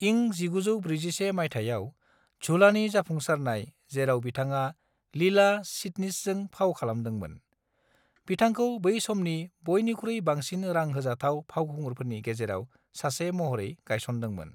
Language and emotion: Bodo, neutral